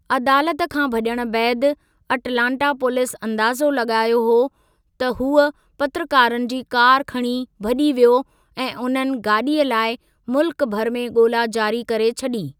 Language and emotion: Sindhi, neutral